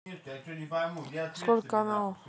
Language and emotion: Russian, neutral